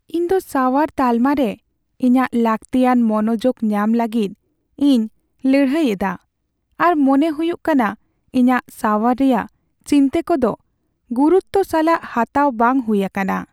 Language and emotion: Santali, sad